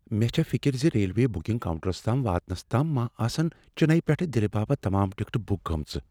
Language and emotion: Kashmiri, fearful